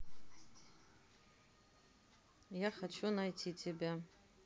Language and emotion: Russian, neutral